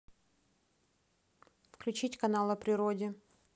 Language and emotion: Russian, neutral